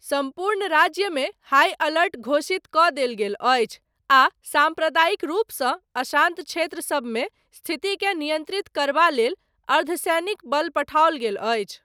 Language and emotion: Maithili, neutral